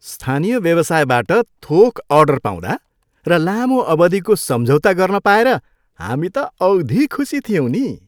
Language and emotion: Nepali, happy